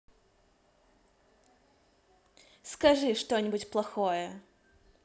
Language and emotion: Russian, positive